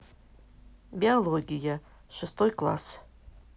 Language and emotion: Russian, neutral